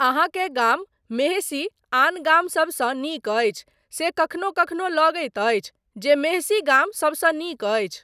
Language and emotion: Maithili, neutral